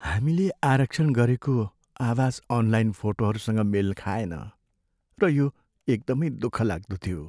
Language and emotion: Nepali, sad